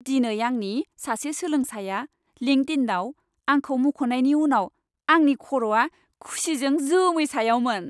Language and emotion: Bodo, happy